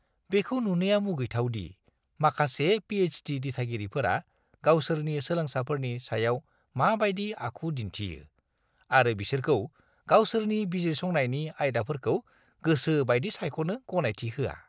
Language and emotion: Bodo, disgusted